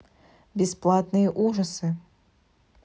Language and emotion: Russian, neutral